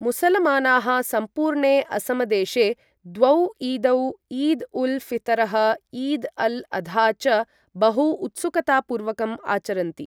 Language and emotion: Sanskrit, neutral